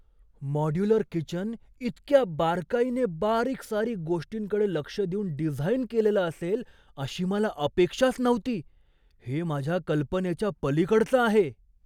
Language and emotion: Marathi, surprised